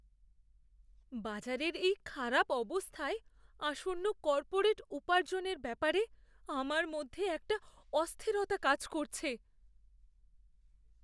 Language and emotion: Bengali, fearful